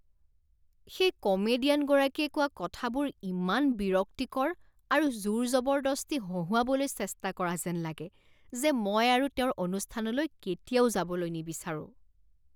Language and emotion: Assamese, disgusted